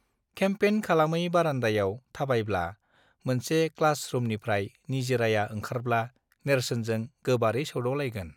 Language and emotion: Bodo, neutral